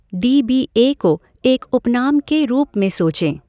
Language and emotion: Hindi, neutral